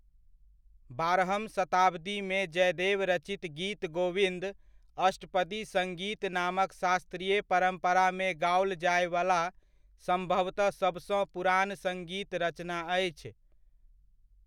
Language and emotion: Maithili, neutral